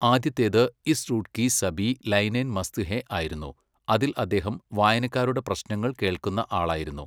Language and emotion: Malayalam, neutral